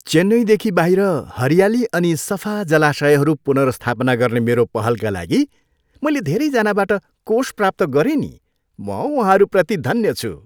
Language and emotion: Nepali, happy